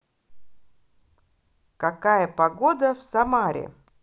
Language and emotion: Russian, positive